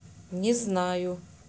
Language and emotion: Russian, neutral